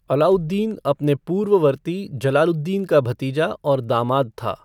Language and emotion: Hindi, neutral